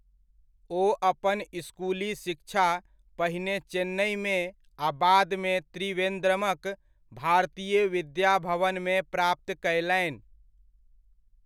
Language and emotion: Maithili, neutral